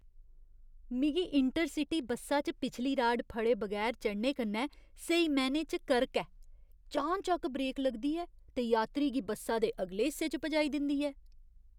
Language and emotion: Dogri, disgusted